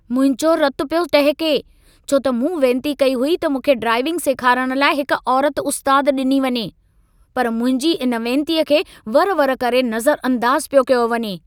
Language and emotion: Sindhi, angry